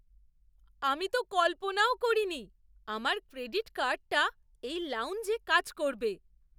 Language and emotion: Bengali, surprised